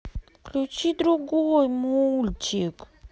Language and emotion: Russian, sad